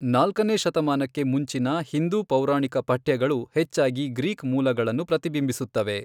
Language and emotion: Kannada, neutral